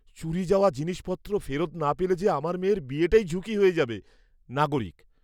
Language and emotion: Bengali, fearful